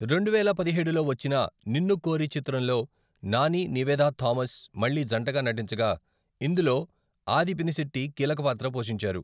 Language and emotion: Telugu, neutral